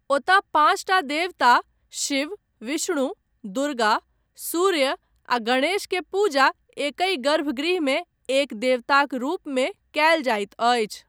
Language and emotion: Maithili, neutral